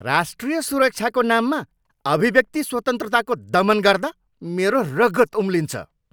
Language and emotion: Nepali, angry